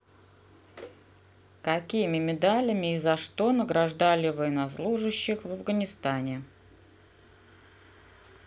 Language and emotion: Russian, neutral